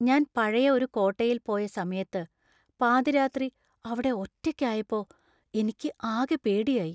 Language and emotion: Malayalam, fearful